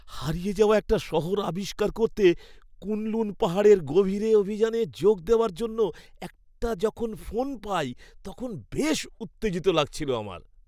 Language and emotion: Bengali, happy